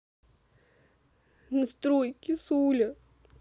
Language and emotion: Russian, sad